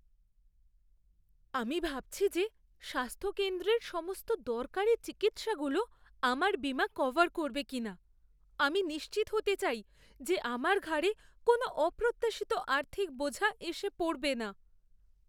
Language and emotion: Bengali, fearful